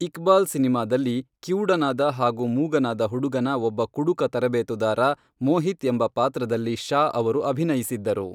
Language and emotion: Kannada, neutral